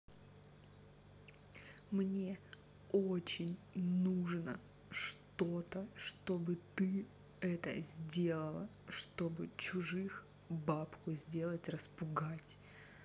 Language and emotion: Russian, angry